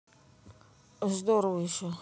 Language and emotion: Russian, neutral